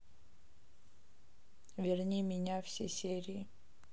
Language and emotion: Russian, neutral